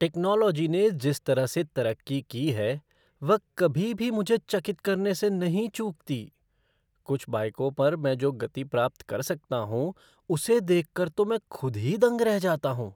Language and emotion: Hindi, surprised